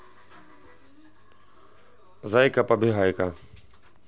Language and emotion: Russian, neutral